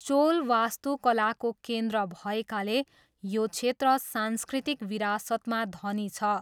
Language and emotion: Nepali, neutral